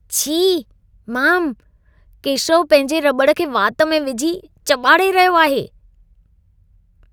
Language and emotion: Sindhi, disgusted